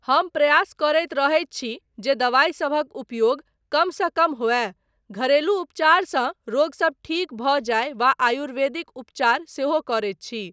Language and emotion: Maithili, neutral